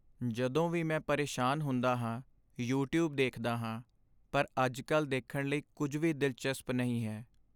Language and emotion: Punjabi, sad